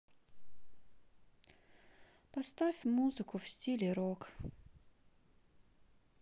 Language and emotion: Russian, sad